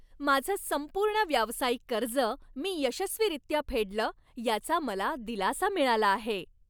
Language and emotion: Marathi, happy